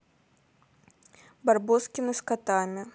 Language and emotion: Russian, neutral